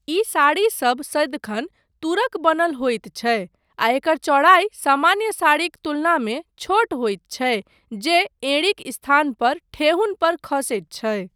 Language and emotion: Maithili, neutral